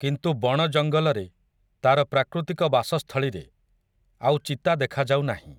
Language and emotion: Odia, neutral